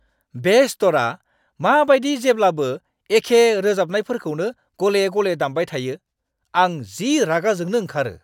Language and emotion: Bodo, angry